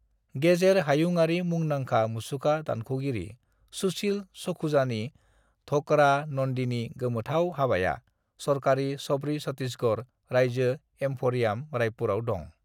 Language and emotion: Bodo, neutral